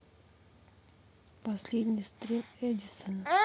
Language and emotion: Russian, neutral